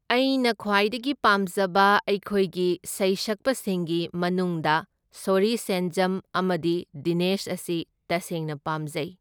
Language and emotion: Manipuri, neutral